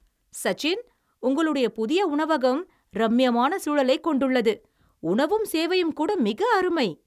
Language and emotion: Tamil, happy